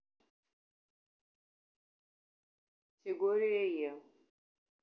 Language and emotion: Russian, neutral